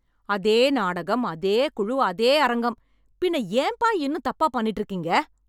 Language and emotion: Tamil, angry